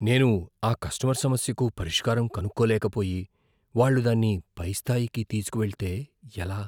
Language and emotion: Telugu, fearful